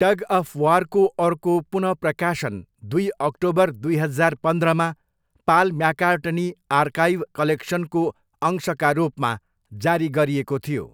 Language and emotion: Nepali, neutral